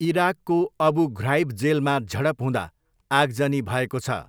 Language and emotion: Nepali, neutral